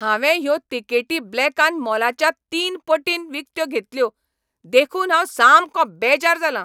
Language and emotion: Goan Konkani, angry